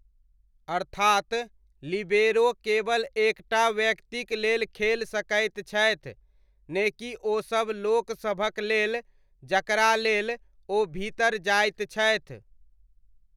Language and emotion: Maithili, neutral